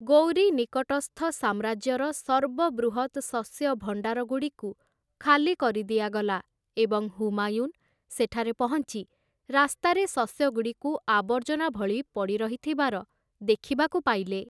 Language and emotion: Odia, neutral